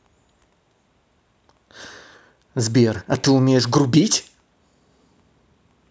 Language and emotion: Russian, angry